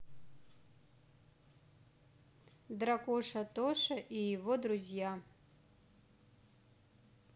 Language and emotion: Russian, neutral